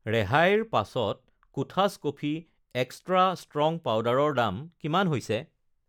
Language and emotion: Assamese, neutral